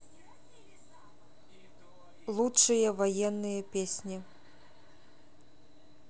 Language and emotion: Russian, neutral